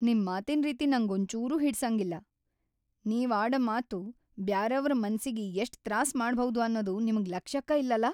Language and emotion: Kannada, angry